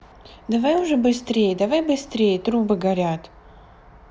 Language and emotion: Russian, neutral